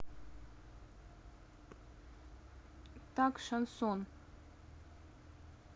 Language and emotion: Russian, neutral